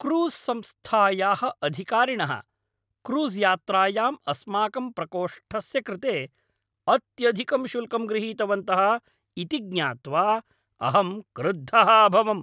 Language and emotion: Sanskrit, angry